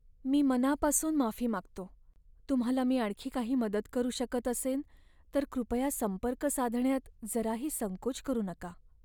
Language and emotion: Marathi, sad